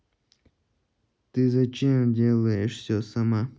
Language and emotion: Russian, neutral